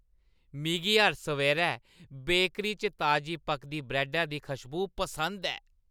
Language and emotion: Dogri, happy